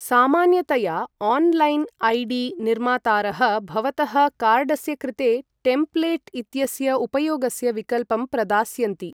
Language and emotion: Sanskrit, neutral